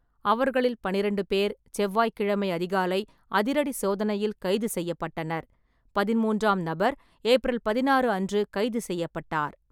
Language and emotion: Tamil, neutral